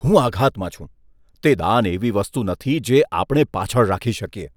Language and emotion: Gujarati, disgusted